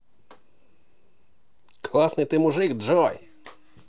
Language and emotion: Russian, positive